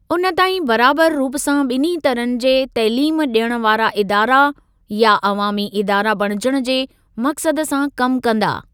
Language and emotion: Sindhi, neutral